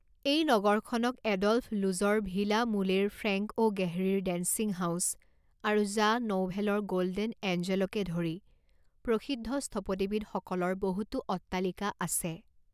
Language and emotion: Assamese, neutral